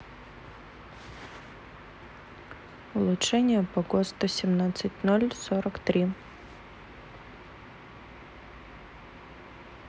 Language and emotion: Russian, neutral